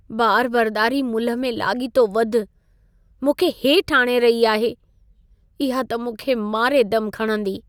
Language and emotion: Sindhi, sad